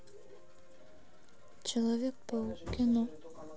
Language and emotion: Russian, sad